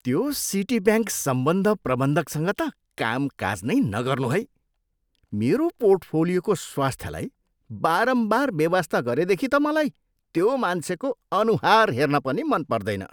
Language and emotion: Nepali, disgusted